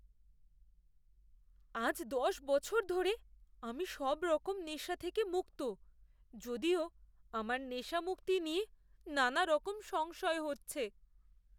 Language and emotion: Bengali, fearful